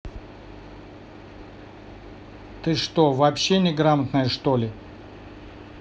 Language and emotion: Russian, angry